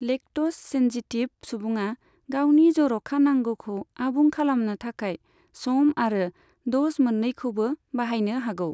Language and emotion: Bodo, neutral